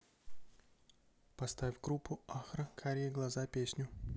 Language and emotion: Russian, neutral